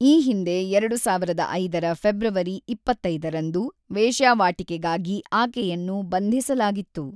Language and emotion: Kannada, neutral